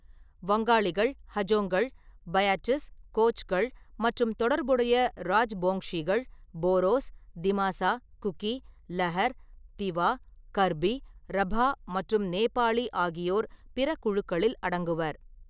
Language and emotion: Tamil, neutral